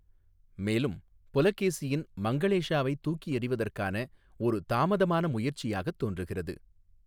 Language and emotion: Tamil, neutral